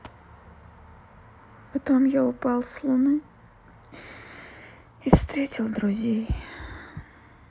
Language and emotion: Russian, sad